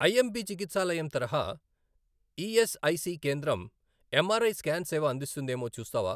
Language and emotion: Telugu, neutral